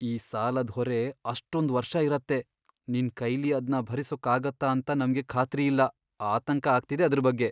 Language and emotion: Kannada, fearful